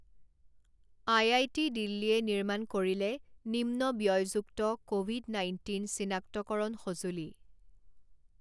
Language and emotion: Assamese, neutral